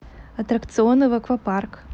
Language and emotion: Russian, neutral